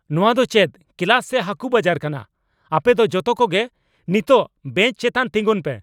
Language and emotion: Santali, angry